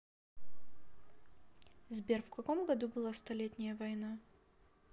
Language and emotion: Russian, neutral